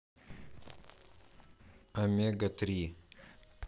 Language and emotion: Russian, neutral